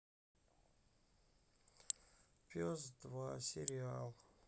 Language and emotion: Russian, sad